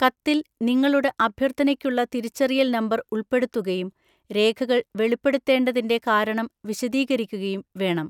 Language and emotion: Malayalam, neutral